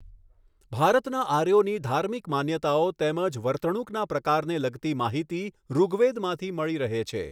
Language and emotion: Gujarati, neutral